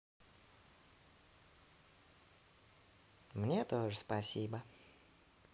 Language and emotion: Russian, positive